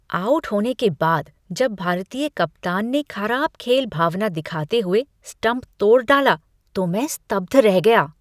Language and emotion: Hindi, disgusted